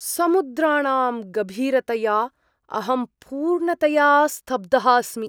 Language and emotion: Sanskrit, surprised